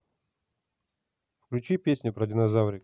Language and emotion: Russian, neutral